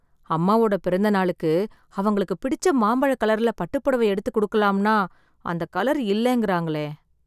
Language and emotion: Tamil, sad